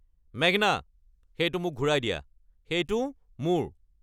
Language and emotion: Assamese, angry